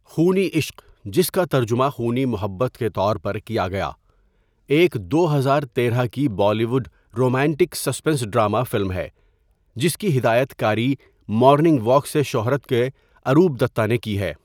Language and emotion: Urdu, neutral